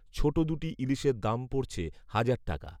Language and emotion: Bengali, neutral